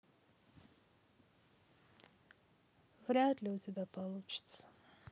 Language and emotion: Russian, sad